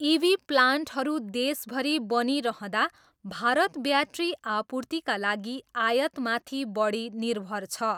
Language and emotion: Nepali, neutral